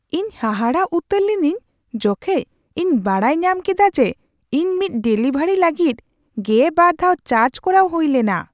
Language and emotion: Santali, surprised